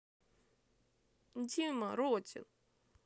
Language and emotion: Russian, sad